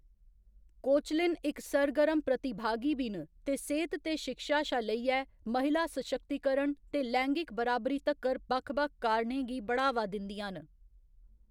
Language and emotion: Dogri, neutral